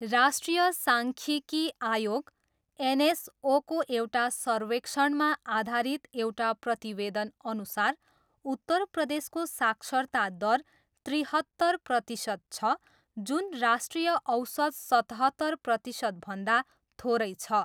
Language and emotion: Nepali, neutral